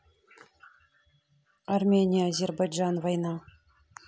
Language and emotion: Russian, neutral